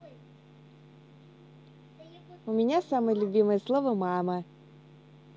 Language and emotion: Russian, positive